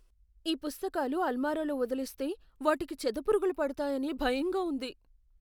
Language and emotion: Telugu, fearful